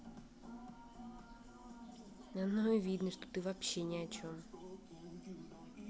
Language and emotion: Russian, angry